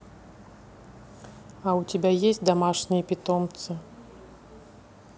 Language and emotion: Russian, neutral